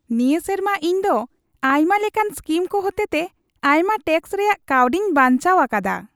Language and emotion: Santali, happy